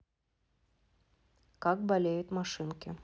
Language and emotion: Russian, neutral